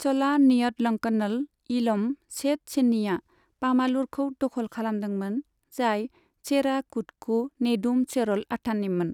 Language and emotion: Bodo, neutral